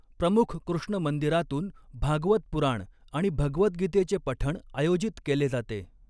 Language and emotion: Marathi, neutral